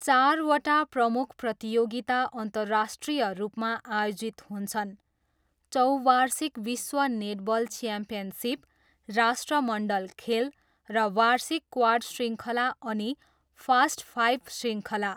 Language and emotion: Nepali, neutral